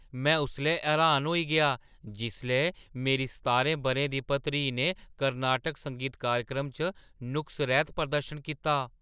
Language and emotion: Dogri, surprised